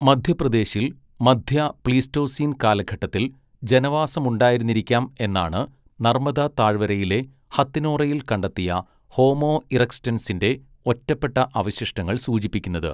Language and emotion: Malayalam, neutral